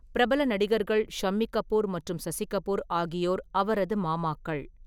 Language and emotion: Tamil, neutral